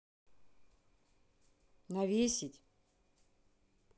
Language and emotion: Russian, neutral